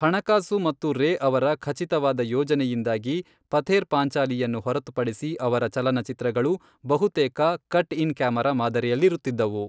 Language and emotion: Kannada, neutral